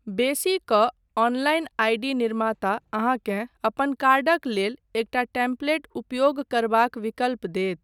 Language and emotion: Maithili, neutral